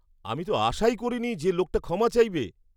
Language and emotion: Bengali, surprised